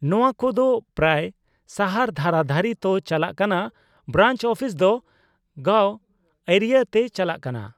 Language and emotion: Santali, neutral